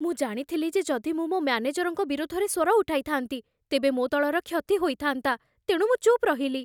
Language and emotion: Odia, fearful